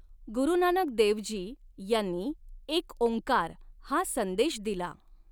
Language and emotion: Marathi, neutral